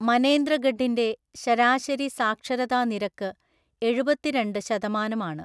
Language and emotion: Malayalam, neutral